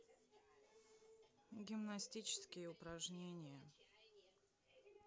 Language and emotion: Russian, sad